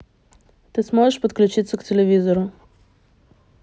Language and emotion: Russian, neutral